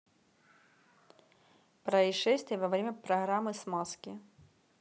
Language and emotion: Russian, neutral